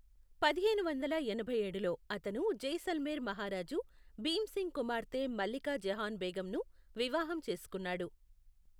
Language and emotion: Telugu, neutral